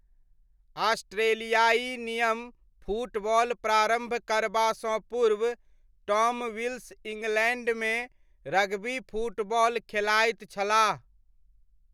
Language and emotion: Maithili, neutral